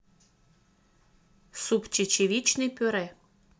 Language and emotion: Russian, neutral